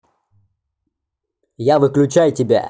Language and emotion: Russian, angry